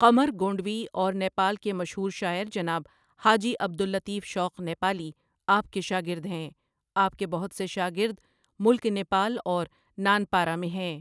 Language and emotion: Urdu, neutral